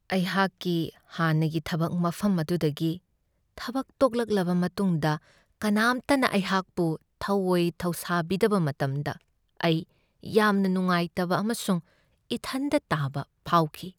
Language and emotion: Manipuri, sad